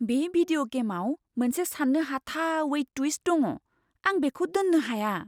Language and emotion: Bodo, surprised